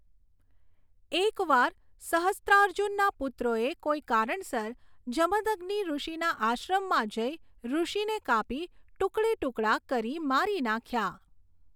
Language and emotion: Gujarati, neutral